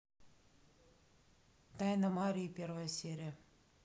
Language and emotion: Russian, neutral